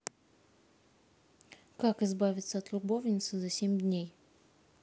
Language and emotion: Russian, neutral